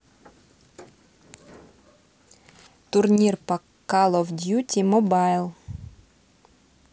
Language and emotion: Russian, neutral